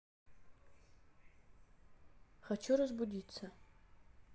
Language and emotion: Russian, neutral